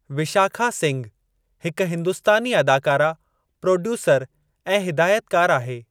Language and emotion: Sindhi, neutral